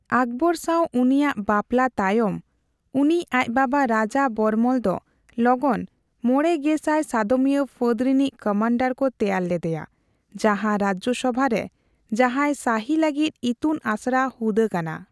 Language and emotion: Santali, neutral